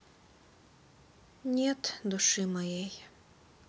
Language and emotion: Russian, sad